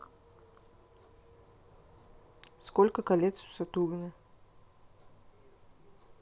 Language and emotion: Russian, neutral